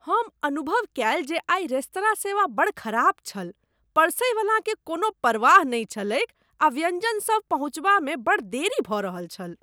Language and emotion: Maithili, disgusted